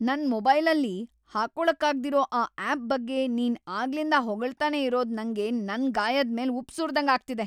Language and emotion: Kannada, angry